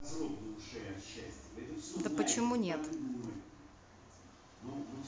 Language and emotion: Russian, neutral